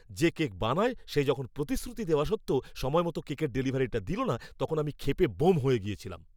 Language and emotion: Bengali, angry